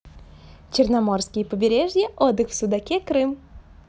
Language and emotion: Russian, positive